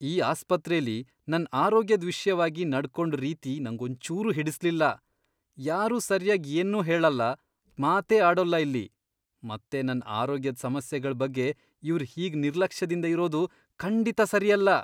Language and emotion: Kannada, disgusted